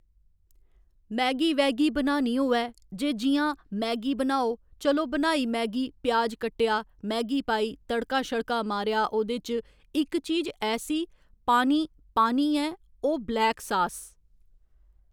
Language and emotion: Dogri, neutral